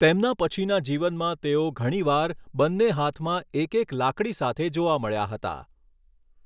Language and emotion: Gujarati, neutral